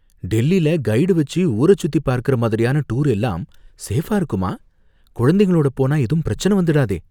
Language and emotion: Tamil, fearful